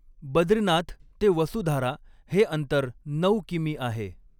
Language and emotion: Marathi, neutral